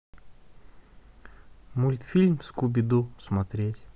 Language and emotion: Russian, neutral